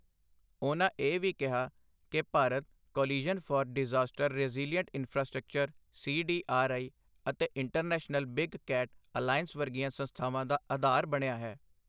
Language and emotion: Punjabi, neutral